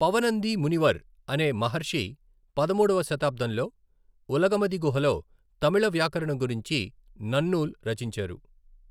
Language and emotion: Telugu, neutral